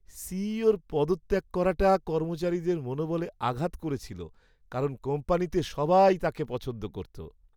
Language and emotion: Bengali, sad